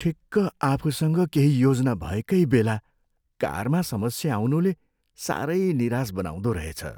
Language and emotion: Nepali, sad